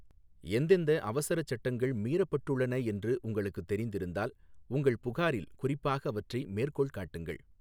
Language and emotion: Tamil, neutral